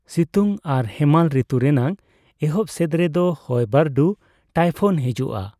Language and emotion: Santali, neutral